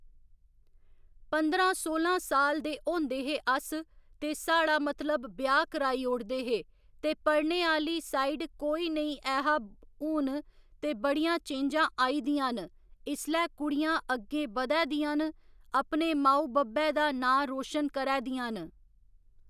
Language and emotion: Dogri, neutral